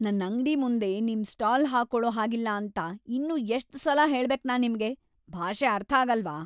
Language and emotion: Kannada, angry